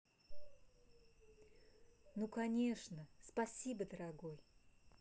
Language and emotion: Russian, positive